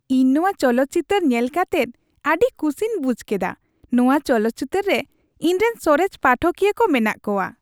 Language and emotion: Santali, happy